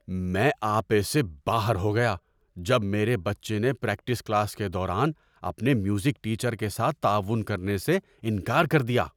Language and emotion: Urdu, angry